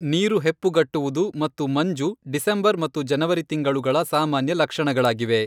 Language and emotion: Kannada, neutral